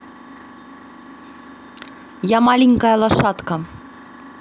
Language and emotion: Russian, neutral